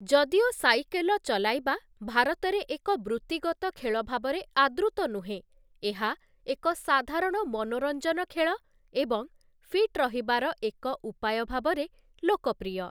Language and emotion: Odia, neutral